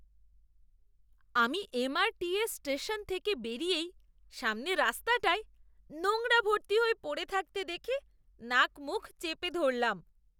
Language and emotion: Bengali, disgusted